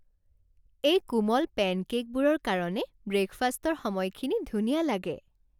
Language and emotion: Assamese, happy